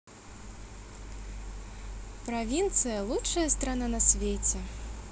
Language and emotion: Russian, positive